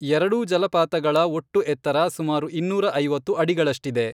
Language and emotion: Kannada, neutral